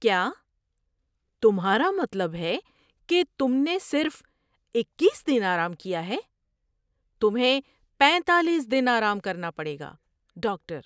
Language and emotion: Urdu, surprised